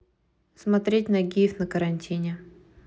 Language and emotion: Russian, neutral